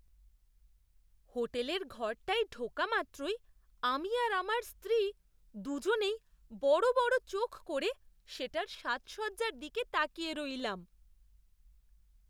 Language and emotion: Bengali, surprised